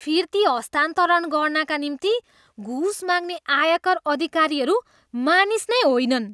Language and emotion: Nepali, disgusted